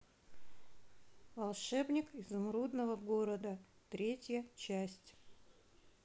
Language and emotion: Russian, neutral